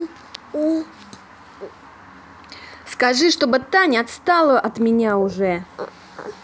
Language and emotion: Russian, angry